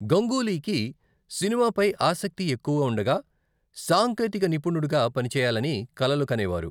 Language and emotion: Telugu, neutral